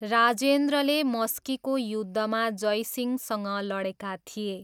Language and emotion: Nepali, neutral